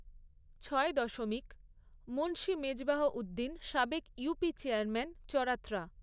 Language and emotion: Bengali, neutral